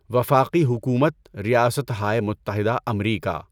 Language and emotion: Urdu, neutral